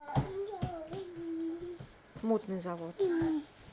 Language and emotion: Russian, neutral